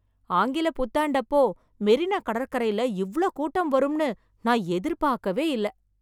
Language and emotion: Tamil, surprised